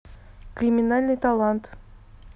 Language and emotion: Russian, neutral